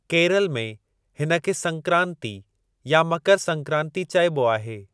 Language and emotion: Sindhi, neutral